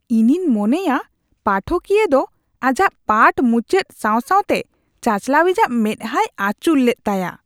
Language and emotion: Santali, disgusted